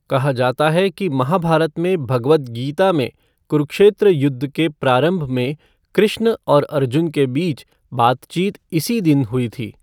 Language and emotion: Hindi, neutral